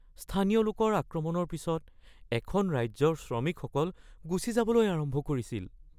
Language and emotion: Assamese, fearful